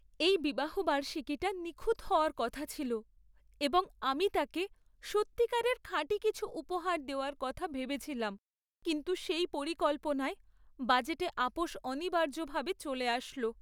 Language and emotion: Bengali, sad